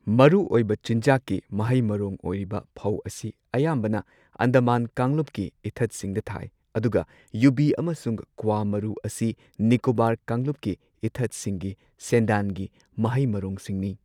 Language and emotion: Manipuri, neutral